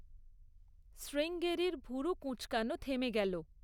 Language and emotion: Bengali, neutral